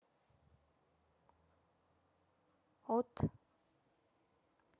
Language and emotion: Russian, neutral